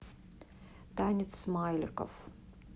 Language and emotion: Russian, neutral